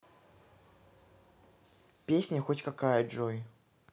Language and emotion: Russian, neutral